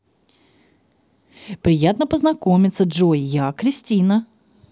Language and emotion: Russian, positive